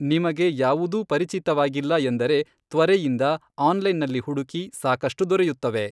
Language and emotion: Kannada, neutral